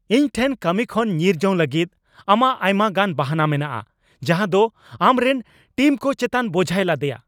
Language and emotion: Santali, angry